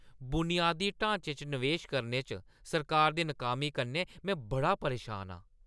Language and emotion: Dogri, angry